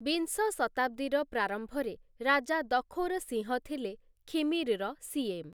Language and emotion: Odia, neutral